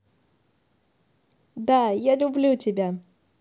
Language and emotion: Russian, positive